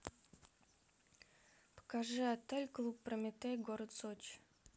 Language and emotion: Russian, neutral